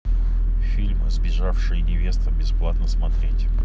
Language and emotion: Russian, neutral